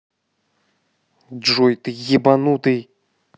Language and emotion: Russian, angry